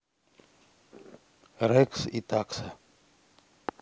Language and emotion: Russian, neutral